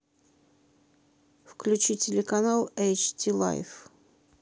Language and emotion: Russian, neutral